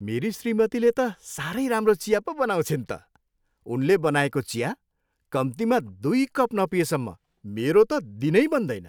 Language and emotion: Nepali, happy